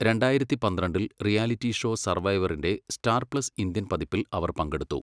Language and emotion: Malayalam, neutral